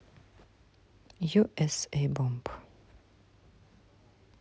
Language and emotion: Russian, neutral